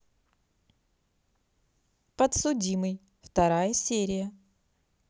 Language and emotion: Russian, positive